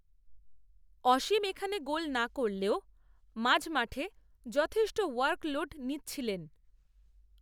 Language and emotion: Bengali, neutral